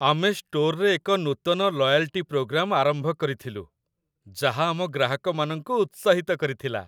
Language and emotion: Odia, happy